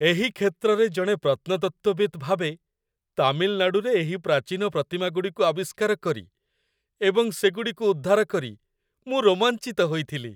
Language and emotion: Odia, happy